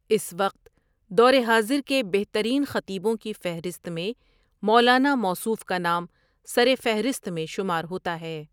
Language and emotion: Urdu, neutral